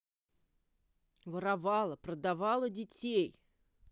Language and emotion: Russian, angry